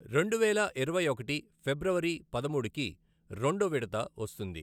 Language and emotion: Telugu, neutral